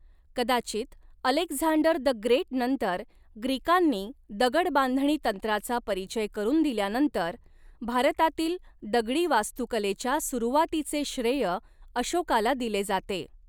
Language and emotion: Marathi, neutral